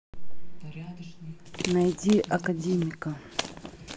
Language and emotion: Russian, neutral